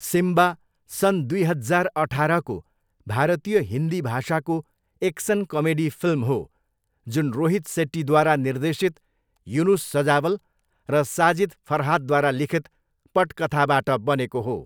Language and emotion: Nepali, neutral